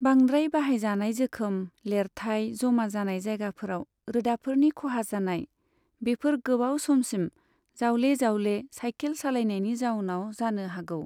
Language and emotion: Bodo, neutral